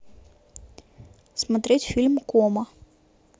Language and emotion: Russian, neutral